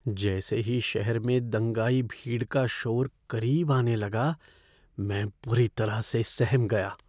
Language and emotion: Hindi, fearful